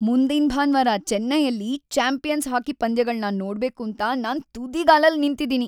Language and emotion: Kannada, happy